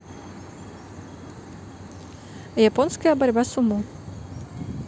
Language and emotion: Russian, neutral